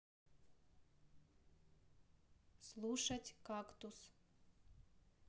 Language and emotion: Russian, neutral